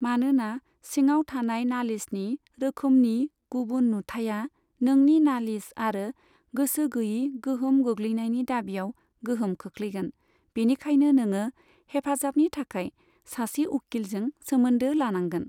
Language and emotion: Bodo, neutral